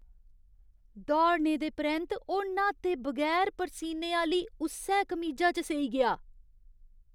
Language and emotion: Dogri, disgusted